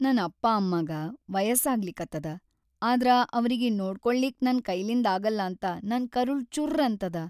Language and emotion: Kannada, sad